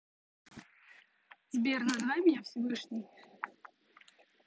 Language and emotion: Russian, neutral